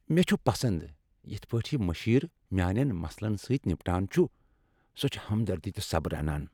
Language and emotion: Kashmiri, happy